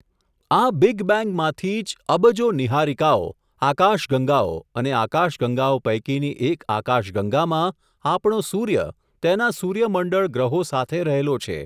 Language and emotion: Gujarati, neutral